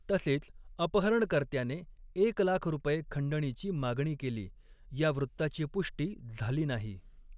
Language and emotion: Marathi, neutral